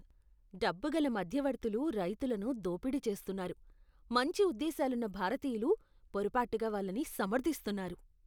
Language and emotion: Telugu, disgusted